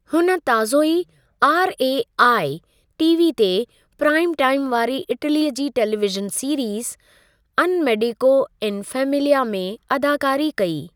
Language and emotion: Sindhi, neutral